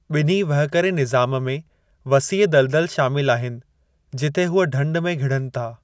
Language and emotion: Sindhi, neutral